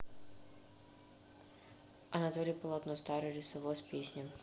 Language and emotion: Russian, neutral